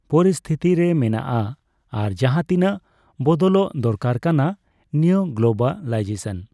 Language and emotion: Santali, neutral